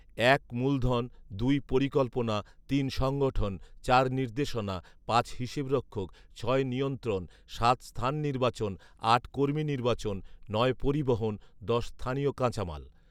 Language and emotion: Bengali, neutral